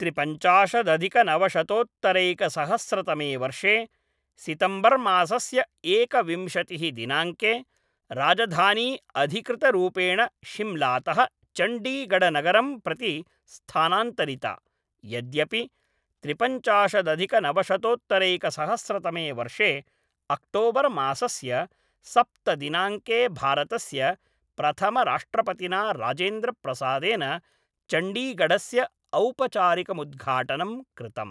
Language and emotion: Sanskrit, neutral